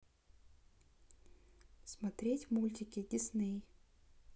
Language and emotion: Russian, neutral